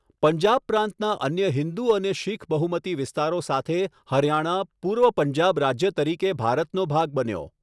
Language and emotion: Gujarati, neutral